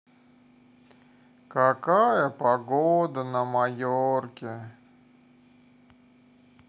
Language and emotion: Russian, sad